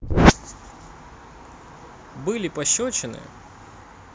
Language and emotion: Russian, neutral